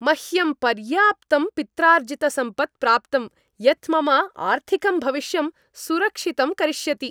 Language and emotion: Sanskrit, happy